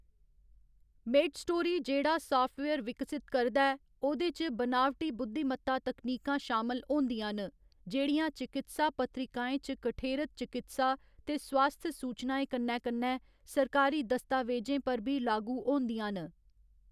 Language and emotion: Dogri, neutral